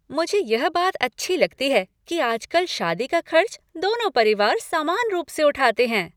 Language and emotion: Hindi, happy